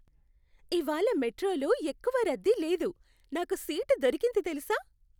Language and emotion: Telugu, happy